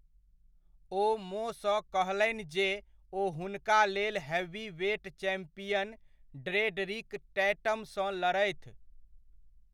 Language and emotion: Maithili, neutral